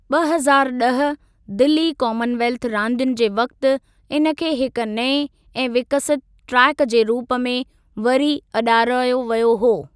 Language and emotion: Sindhi, neutral